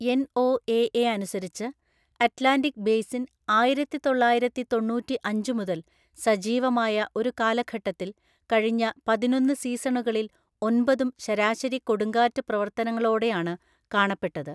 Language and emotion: Malayalam, neutral